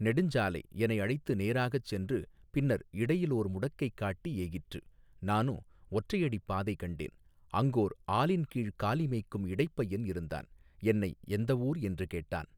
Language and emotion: Tamil, neutral